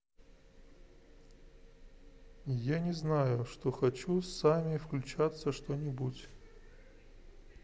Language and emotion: Russian, neutral